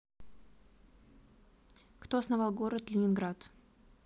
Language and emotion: Russian, neutral